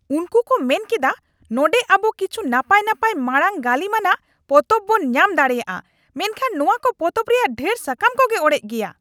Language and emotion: Santali, angry